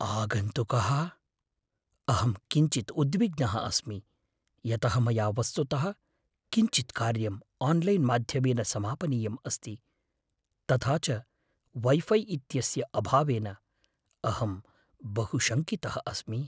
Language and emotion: Sanskrit, fearful